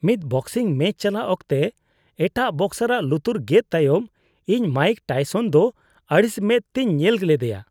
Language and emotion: Santali, disgusted